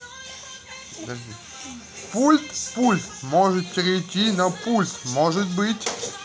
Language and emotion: Russian, positive